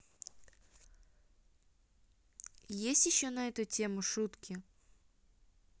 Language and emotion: Russian, neutral